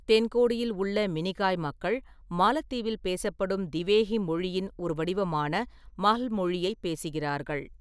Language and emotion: Tamil, neutral